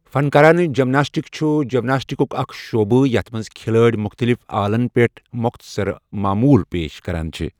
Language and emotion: Kashmiri, neutral